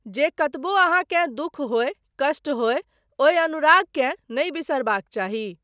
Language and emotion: Maithili, neutral